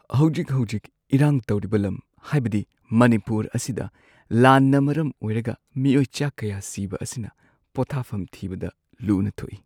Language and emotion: Manipuri, sad